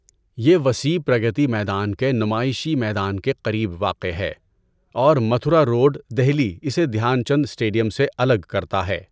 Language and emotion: Urdu, neutral